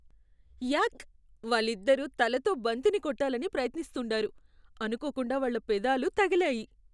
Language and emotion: Telugu, disgusted